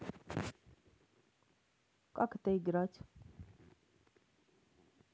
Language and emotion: Russian, neutral